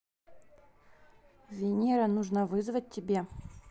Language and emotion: Russian, neutral